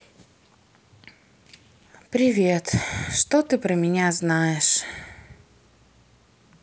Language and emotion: Russian, sad